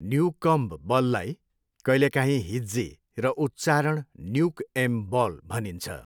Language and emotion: Nepali, neutral